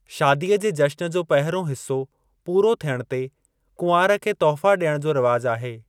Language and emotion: Sindhi, neutral